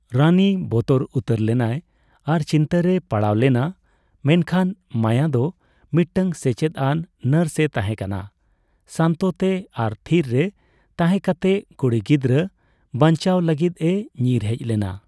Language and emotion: Santali, neutral